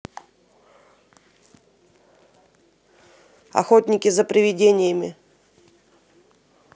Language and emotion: Russian, neutral